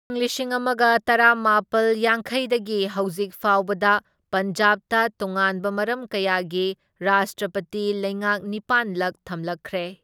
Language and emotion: Manipuri, neutral